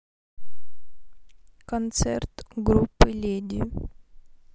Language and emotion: Russian, neutral